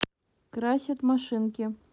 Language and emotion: Russian, neutral